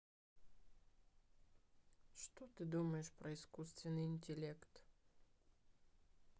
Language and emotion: Russian, sad